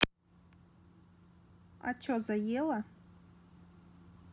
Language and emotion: Russian, neutral